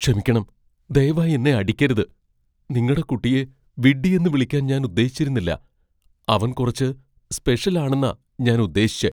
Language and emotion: Malayalam, fearful